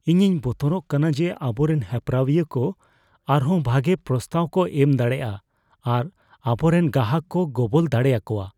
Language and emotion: Santali, fearful